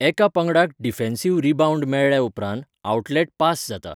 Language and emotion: Goan Konkani, neutral